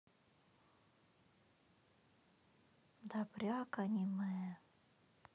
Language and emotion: Russian, sad